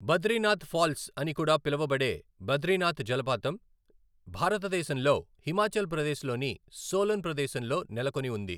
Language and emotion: Telugu, neutral